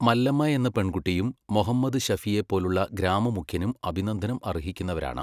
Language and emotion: Malayalam, neutral